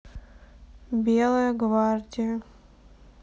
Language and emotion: Russian, sad